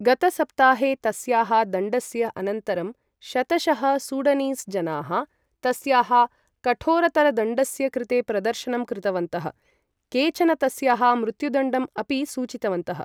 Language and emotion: Sanskrit, neutral